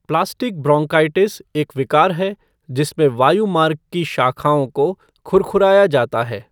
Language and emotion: Hindi, neutral